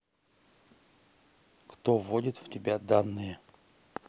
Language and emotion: Russian, neutral